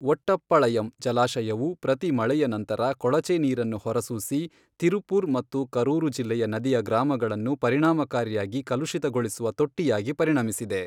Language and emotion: Kannada, neutral